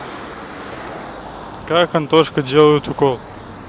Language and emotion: Russian, neutral